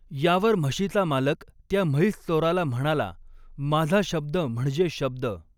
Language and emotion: Marathi, neutral